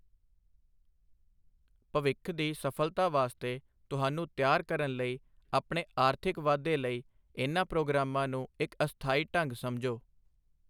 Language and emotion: Punjabi, neutral